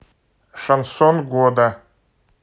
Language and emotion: Russian, neutral